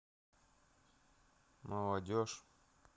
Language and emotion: Russian, neutral